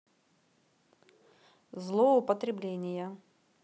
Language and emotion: Russian, neutral